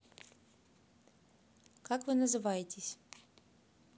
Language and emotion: Russian, neutral